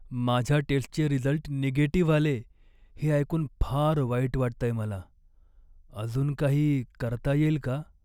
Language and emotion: Marathi, sad